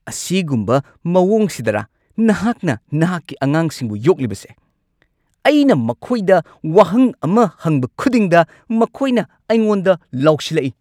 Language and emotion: Manipuri, angry